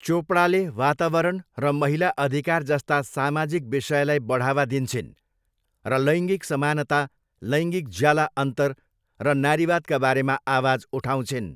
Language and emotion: Nepali, neutral